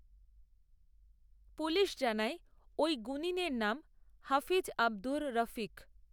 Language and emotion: Bengali, neutral